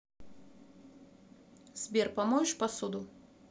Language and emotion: Russian, neutral